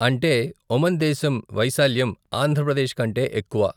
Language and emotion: Telugu, neutral